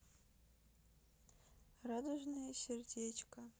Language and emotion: Russian, sad